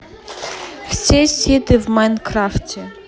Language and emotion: Russian, neutral